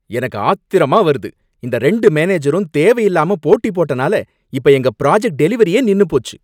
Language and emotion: Tamil, angry